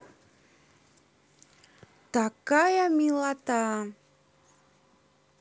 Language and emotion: Russian, positive